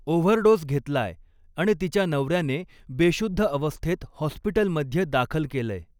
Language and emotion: Marathi, neutral